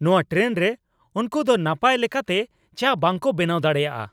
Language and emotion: Santali, angry